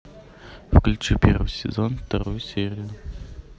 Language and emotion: Russian, neutral